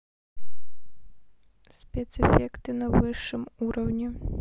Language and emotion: Russian, neutral